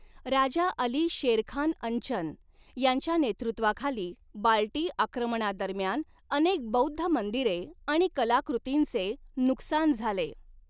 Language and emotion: Marathi, neutral